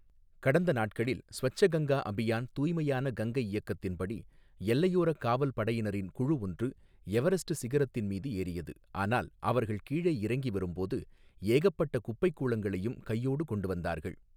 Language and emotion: Tamil, neutral